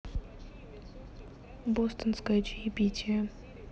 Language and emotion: Russian, neutral